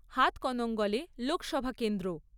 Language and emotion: Bengali, neutral